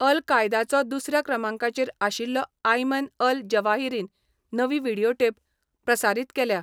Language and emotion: Goan Konkani, neutral